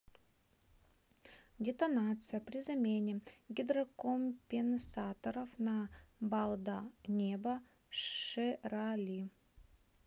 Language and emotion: Russian, neutral